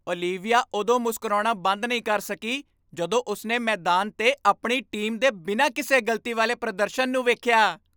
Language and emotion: Punjabi, happy